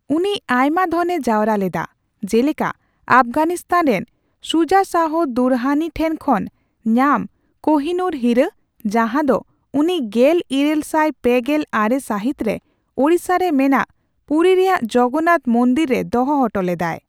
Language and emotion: Santali, neutral